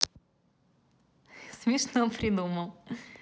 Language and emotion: Russian, positive